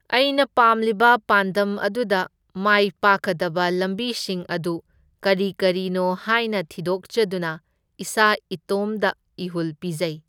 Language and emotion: Manipuri, neutral